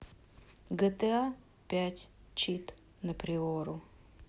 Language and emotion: Russian, neutral